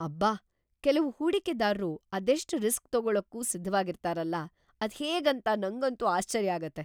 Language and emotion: Kannada, surprised